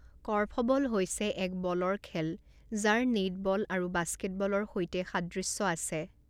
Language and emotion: Assamese, neutral